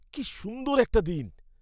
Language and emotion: Bengali, happy